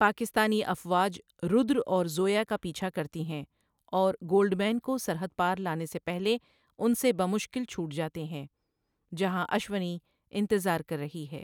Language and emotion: Urdu, neutral